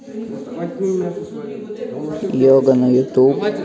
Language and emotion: Russian, neutral